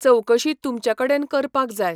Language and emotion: Goan Konkani, neutral